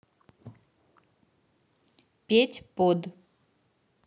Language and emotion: Russian, neutral